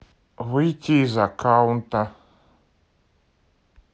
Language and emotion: Russian, neutral